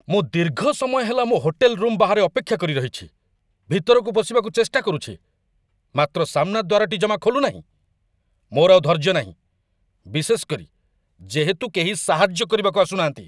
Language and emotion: Odia, angry